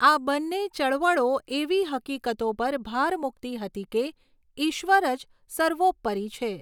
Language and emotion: Gujarati, neutral